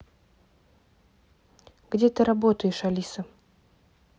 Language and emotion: Russian, neutral